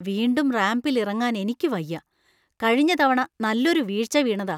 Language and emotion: Malayalam, fearful